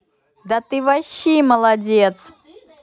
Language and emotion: Russian, positive